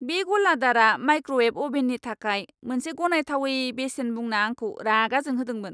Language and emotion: Bodo, angry